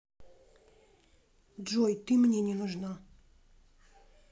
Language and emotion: Russian, neutral